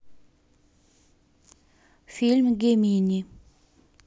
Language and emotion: Russian, neutral